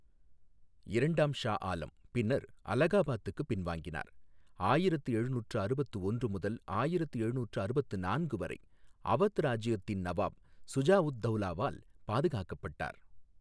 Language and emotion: Tamil, neutral